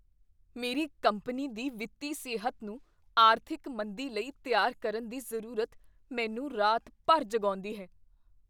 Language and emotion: Punjabi, fearful